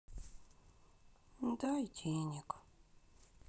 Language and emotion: Russian, sad